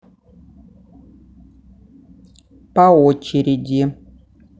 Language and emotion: Russian, neutral